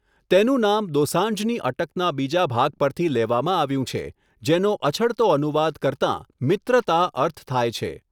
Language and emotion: Gujarati, neutral